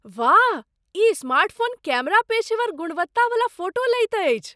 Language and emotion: Maithili, surprised